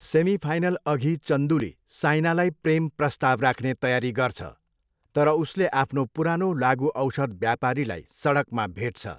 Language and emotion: Nepali, neutral